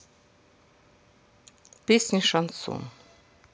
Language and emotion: Russian, neutral